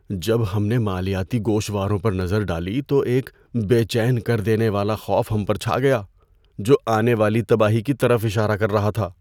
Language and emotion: Urdu, fearful